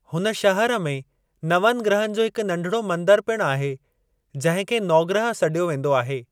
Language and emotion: Sindhi, neutral